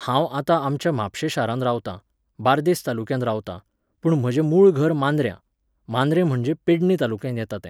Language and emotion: Goan Konkani, neutral